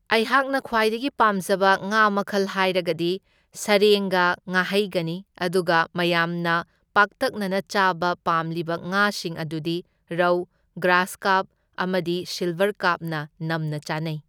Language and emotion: Manipuri, neutral